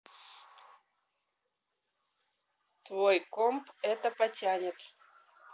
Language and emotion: Russian, neutral